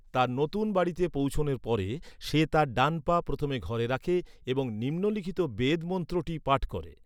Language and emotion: Bengali, neutral